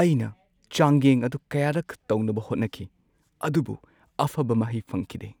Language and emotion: Manipuri, sad